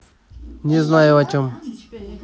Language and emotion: Russian, neutral